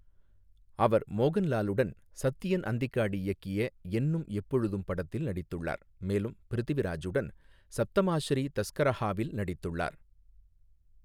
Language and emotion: Tamil, neutral